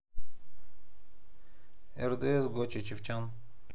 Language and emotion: Russian, neutral